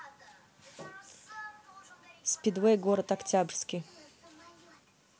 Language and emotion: Russian, neutral